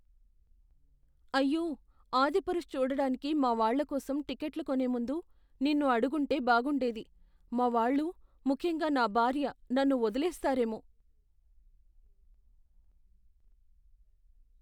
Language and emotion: Telugu, fearful